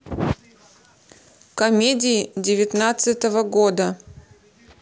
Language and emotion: Russian, neutral